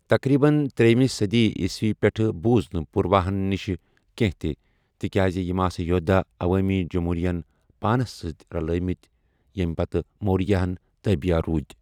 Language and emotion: Kashmiri, neutral